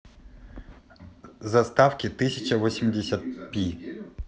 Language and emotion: Russian, neutral